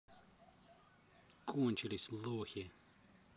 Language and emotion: Russian, neutral